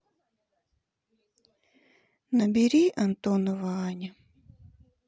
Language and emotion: Russian, sad